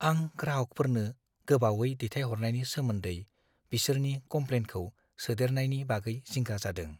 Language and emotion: Bodo, fearful